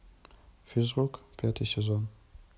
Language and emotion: Russian, neutral